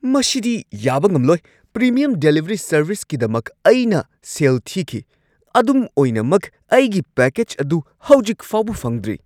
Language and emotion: Manipuri, angry